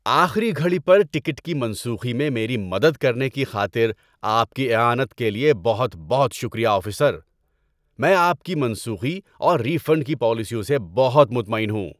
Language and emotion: Urdu, happy